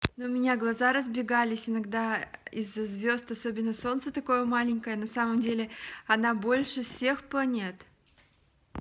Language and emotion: Russian, positive